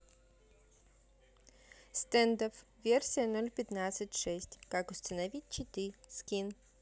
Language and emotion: Russian, neutral